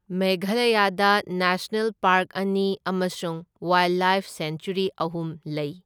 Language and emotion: Manipuri, neutral